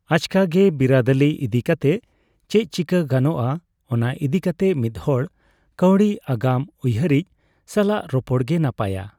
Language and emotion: Santali, neutral